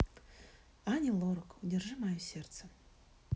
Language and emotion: Russian, sad